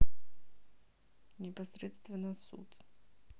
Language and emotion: Russian, neutral